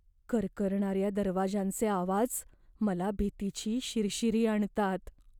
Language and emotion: Marathi, fearful